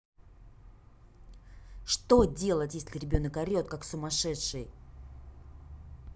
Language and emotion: Russian, angry